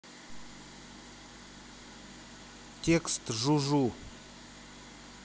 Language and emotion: Russian, neutral